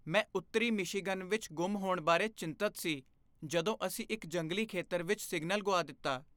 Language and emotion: Punjabi, fearful